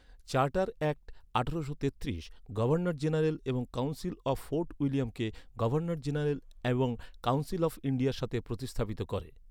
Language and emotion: Bengali, neutral